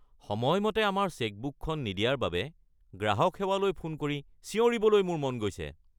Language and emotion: Assamese, angry